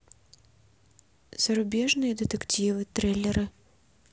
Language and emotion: Russian, neutral